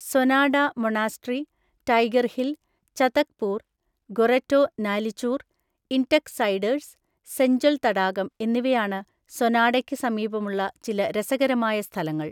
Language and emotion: Malayalam, neutral